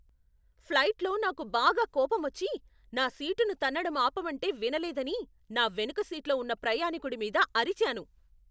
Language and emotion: Telugu, angry